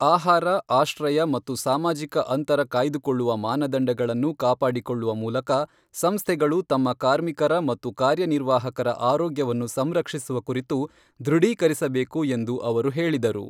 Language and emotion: Kannada, neutral